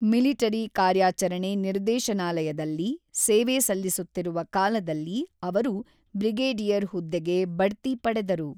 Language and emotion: Kannada, neutral